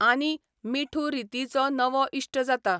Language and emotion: Goan Konkani, neutral